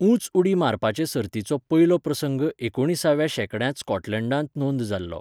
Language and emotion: Goan Konkani, neutral